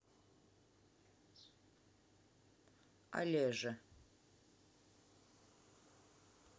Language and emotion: Russian, neutral